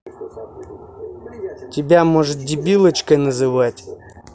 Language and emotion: Russian, angry